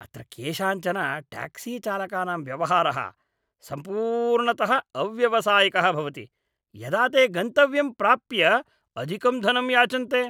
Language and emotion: Sanskrit, disgusted